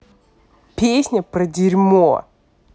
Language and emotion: Russian, angry